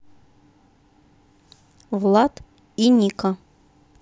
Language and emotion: Russian, neutral